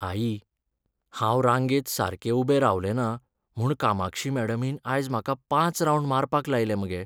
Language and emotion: Goan Konkani, sad